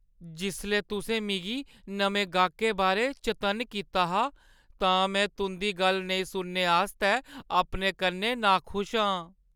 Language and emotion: Dogri, sad